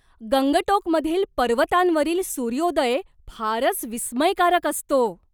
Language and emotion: Marathi, surprised